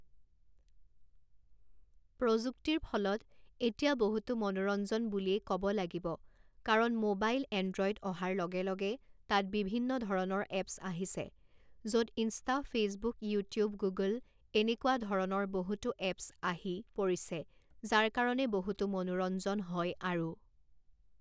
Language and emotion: Assamese, neutral